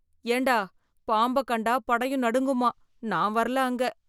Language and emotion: Tamil, fearful